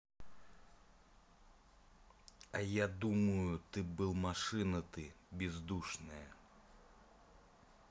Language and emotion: Russian, angry